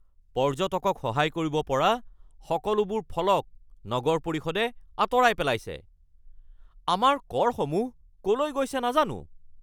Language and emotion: Assamese, angry